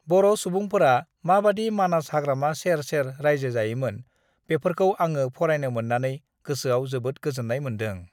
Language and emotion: Bodo, neutral